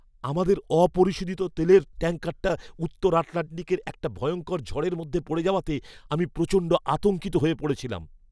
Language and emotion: Bengali, fearful